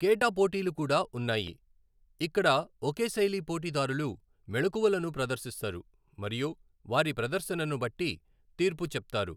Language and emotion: Telugu, neutral